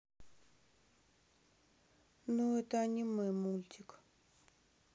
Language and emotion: Russian, sad